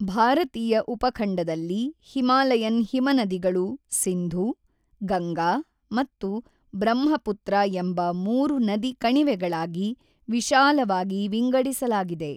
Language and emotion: Kannada, neutral